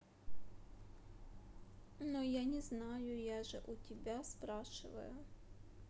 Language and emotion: Russian, sad